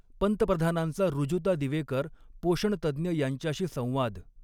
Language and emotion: Marathi, neutral